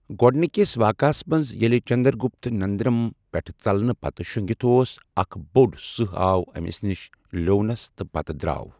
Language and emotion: Kashmiri, neutral